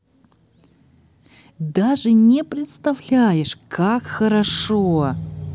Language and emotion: Russian, positive